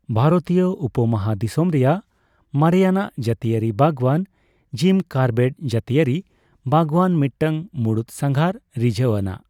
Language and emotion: Santali, neutral